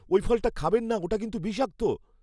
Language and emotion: Bengali, fearful